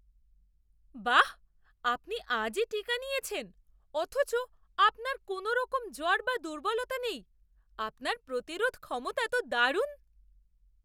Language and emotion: Bengali, surprised